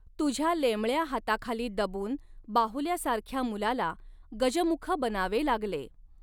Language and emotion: Marathi, neutral